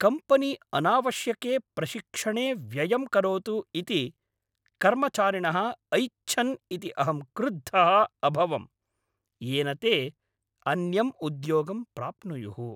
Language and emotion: Sanskrit, angry